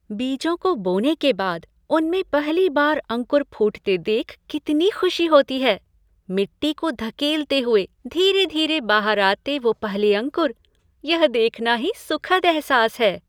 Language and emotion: Hindi, happy